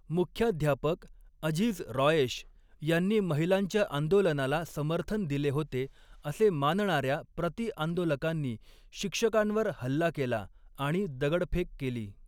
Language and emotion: Marathi, neutral